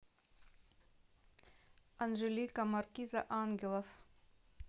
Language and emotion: Russian, neutral